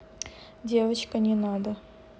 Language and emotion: Russian, neutral